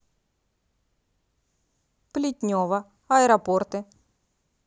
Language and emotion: Russian, neutral